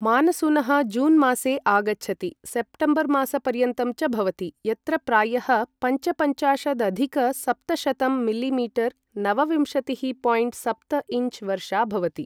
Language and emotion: Sanskrit, neutral